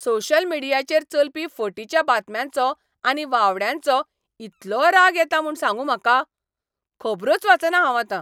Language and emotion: Goan Konkani, angry